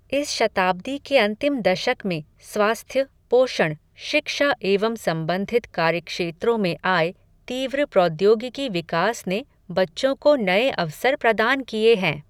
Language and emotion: Hindi, neutral